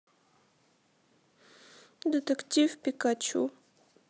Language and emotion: Russian, sad